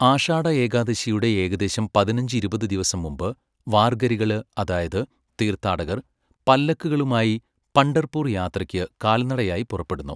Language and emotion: Malayalam, neutral